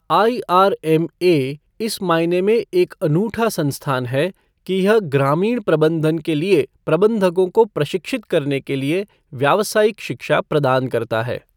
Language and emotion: Hindi, neutral